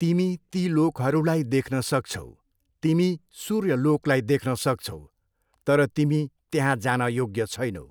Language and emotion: Nepali, neutral